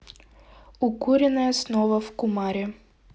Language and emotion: Russian, neutral